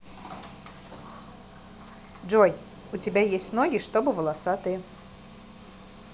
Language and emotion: Russian, neutral